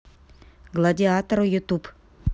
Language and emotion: Russian, neutral